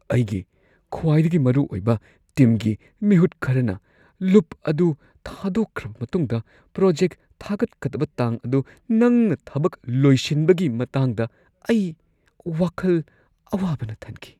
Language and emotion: Manipuri, fearful